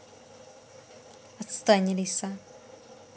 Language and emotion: Russian, angry